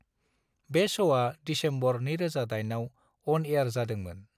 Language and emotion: Bodo, neutral